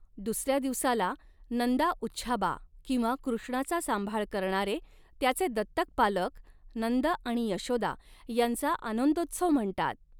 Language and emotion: Marathi, neutral